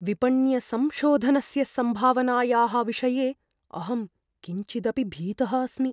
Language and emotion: Sanskrit, fearful